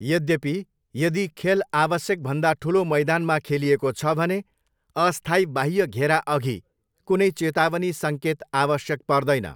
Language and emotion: Nepali, neutral